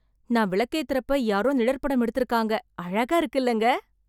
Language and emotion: Tamil, surprised